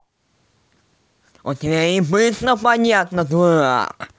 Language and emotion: Russian, angry